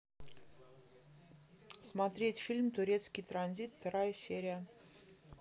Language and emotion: Russian, neutral